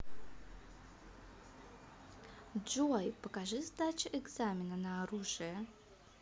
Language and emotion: Russian, positive